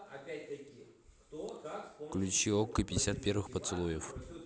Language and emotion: Russian, neutral